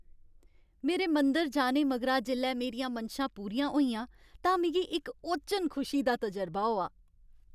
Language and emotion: Dogri, happy